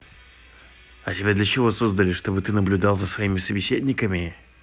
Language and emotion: Russian, angry